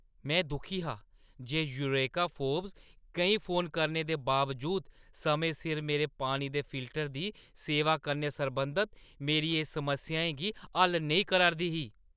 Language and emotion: Dogri, angry